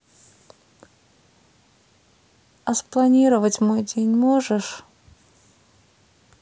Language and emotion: Russian, sad